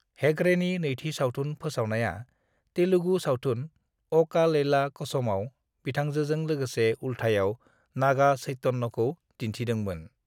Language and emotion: Bodo, neutral